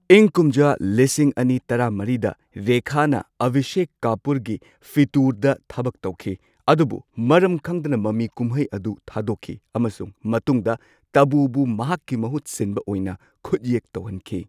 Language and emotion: Manipuri, neutral